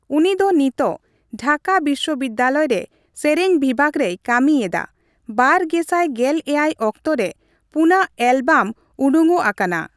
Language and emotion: Santali, neutral